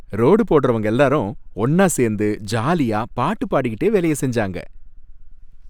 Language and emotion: Tamil, happy